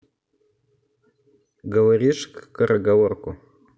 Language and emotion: Russian, neutral